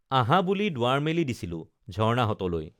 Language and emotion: Assamese, neutral